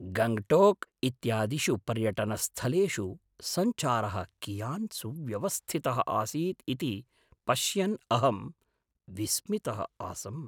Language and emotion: Sanskrit, surprised